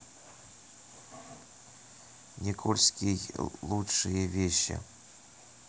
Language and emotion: Russian, neutral